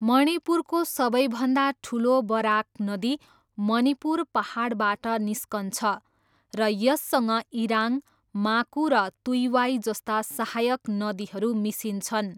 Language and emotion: Nepali, neutral